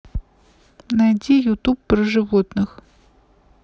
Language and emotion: Russian, neutral